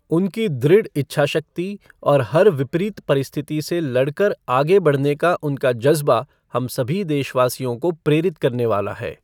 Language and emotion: Hindi, neutral